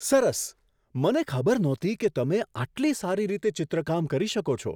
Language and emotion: Gujarati, surprised